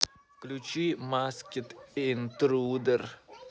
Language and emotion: Russian, neutral